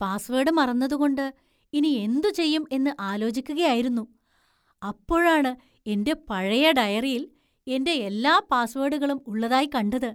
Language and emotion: Malayalam, surprised